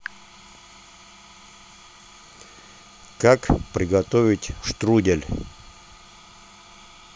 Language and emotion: Russian, neutral